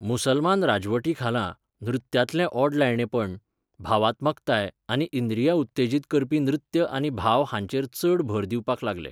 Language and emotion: Goan Konkani, neutral